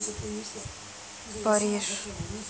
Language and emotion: Russian, neutral